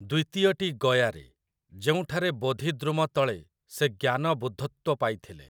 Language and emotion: Odia, neutral